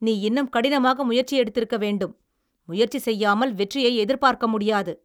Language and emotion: Tamil, angry